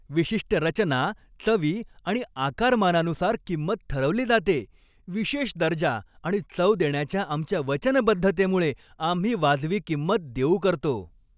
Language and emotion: Marathi, happy